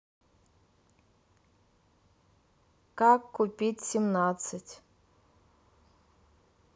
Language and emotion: Russian, neutral